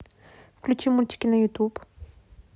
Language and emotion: Russian, neutral